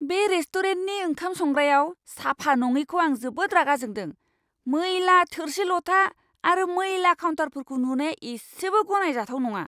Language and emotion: Bodo, angry